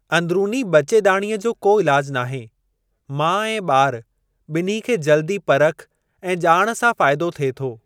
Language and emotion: Sindhi, neutral